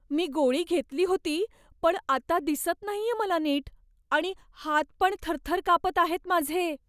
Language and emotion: Marathi, fearful